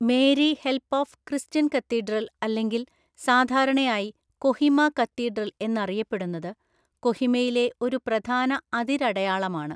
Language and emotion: Malayalam, neutral